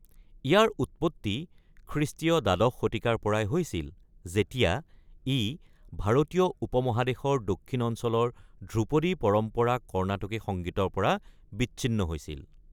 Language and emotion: Assamese, neutral